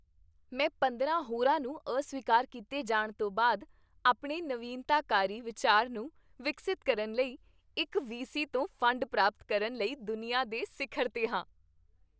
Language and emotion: Punjabi, happy